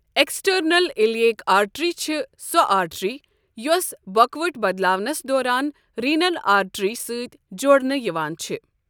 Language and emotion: Kashmiri, neutral